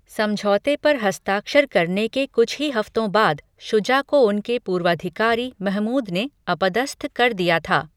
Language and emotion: Hindi, neutral